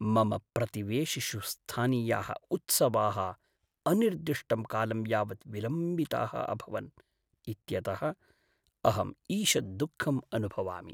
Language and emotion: Sanskrit, sad